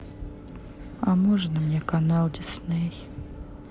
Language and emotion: Russian, sad